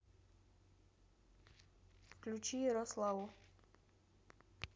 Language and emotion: Russian, neutral